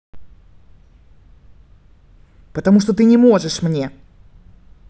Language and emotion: Russian, angry